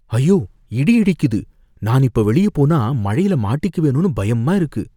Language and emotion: Tamil, fearful